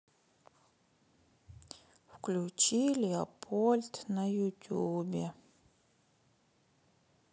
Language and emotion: Russian, sad